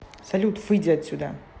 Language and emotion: Russian, angry